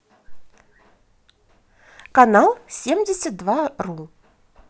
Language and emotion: Russian, positive